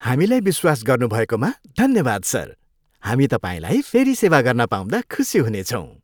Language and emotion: Nepali, happy